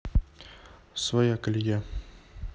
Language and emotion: Russian, neutral